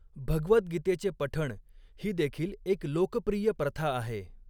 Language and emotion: Marathi, neutral